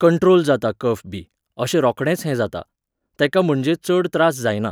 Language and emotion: Goan Konkani, neutral